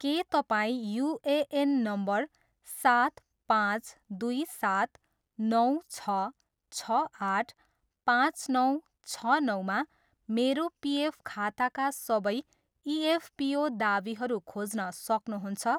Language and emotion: Nepali, neutral